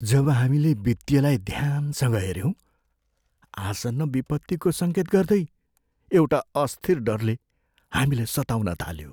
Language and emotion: Nepali, fearful